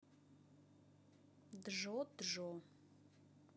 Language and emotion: Russian, neutral